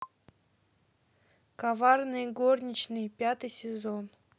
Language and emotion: Russian, neutral